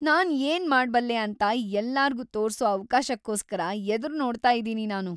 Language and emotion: Kannada, happy